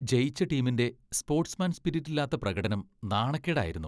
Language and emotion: Malayalam, disgusted